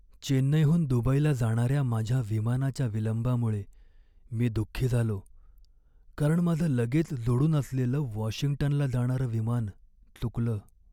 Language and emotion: Marathi, sad